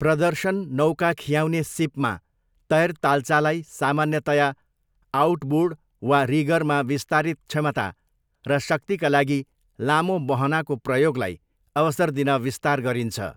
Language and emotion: Nepali, neutral